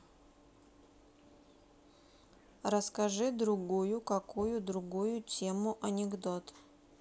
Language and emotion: Russian, neutral